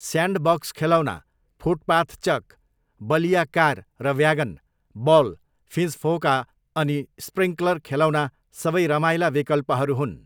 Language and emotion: Nepali, neutral